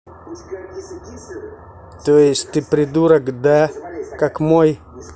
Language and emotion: Russian, angry